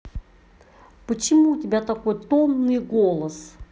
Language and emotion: Russian, angry